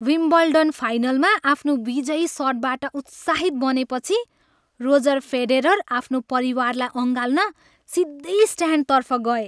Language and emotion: Nepali, happy